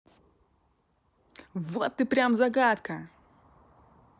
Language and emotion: Russian, positive